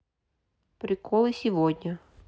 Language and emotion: Russian, neutral